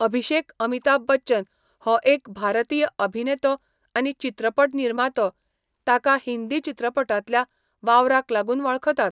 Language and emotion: Goan Konkani, neutral